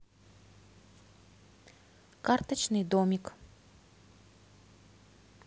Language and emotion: Russian, neutral